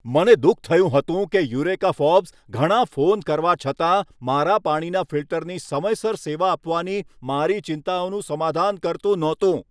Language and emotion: Gujarati, angry